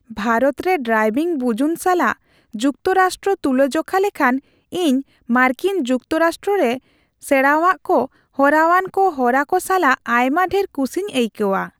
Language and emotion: Santali, happy